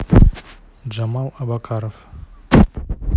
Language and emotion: Russian, neutral